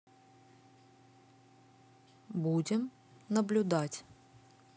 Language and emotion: Russian, neutral